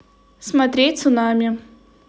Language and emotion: Russian, neutral